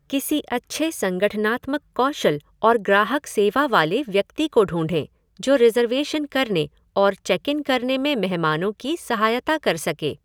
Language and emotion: Hindi, neutral